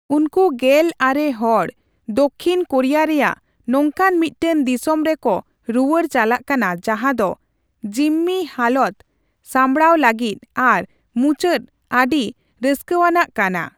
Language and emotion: Santali, neutral